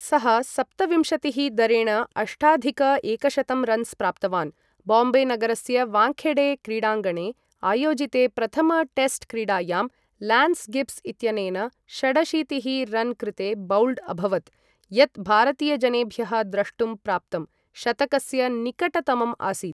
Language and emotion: Sanskrit, neutral